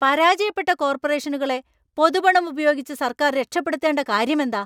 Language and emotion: Malayalam, angry